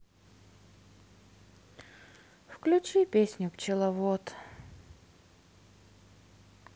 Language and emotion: Russian, sad